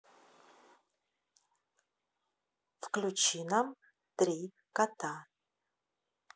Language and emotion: Russian, neutral